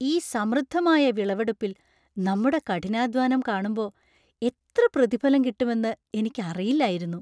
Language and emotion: Malayalam, surprised